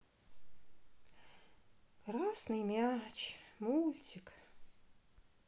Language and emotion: Russian, sad